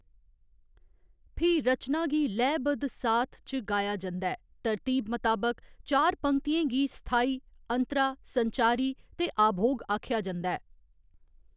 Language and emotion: Dogri, neutral